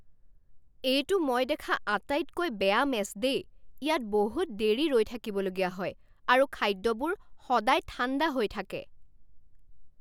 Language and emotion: Assamese, angry